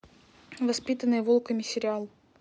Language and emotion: Russian, neutral